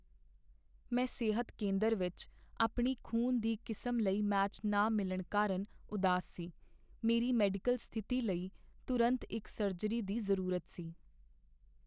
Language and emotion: Punjabi, sad